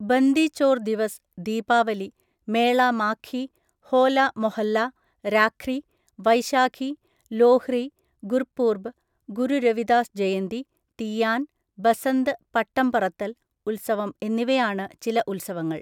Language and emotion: Malayalam, neutral